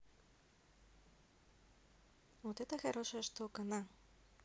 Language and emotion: Russian, neutral